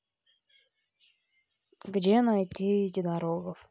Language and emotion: Russian, neutral